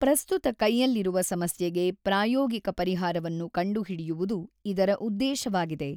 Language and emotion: Kannada, neutral